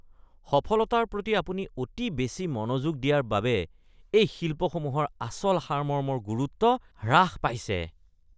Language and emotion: Assamese, disgusted